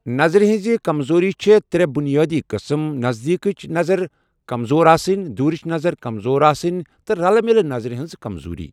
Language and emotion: Kashmiri, neutral